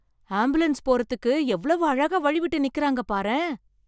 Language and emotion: Tamil, surprised